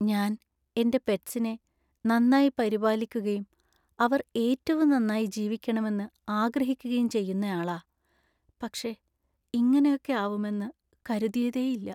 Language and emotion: Malayalam, sad